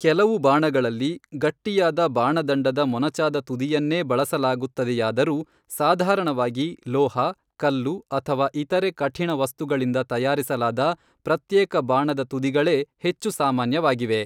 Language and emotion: Kannada, neutral